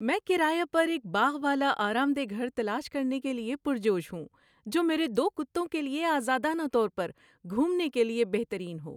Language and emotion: Urdu, happy